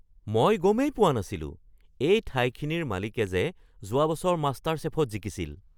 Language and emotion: Assamese, surprised